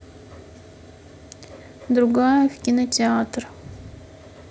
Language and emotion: Russian, neutral